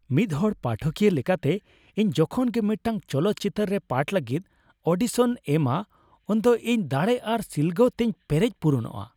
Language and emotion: Santali, happy